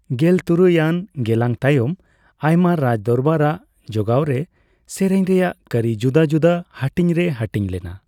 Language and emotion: Santali, neutral